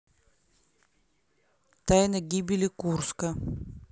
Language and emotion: Russian, neutral